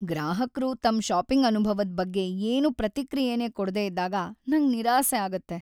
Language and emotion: Kannada, sad